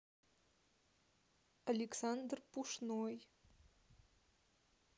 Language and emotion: Russian, neutral